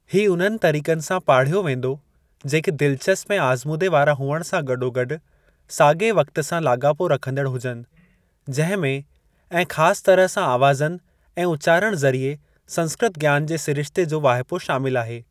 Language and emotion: Sindhi, neutral